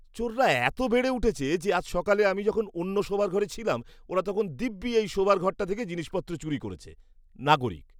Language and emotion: Bengali, disgusted